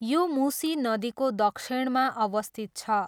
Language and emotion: Nepali, neutral